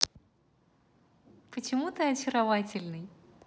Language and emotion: Russian, positive